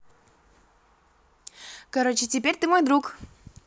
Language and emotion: Russian, positive